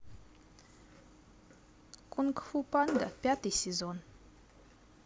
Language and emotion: Russian, neutral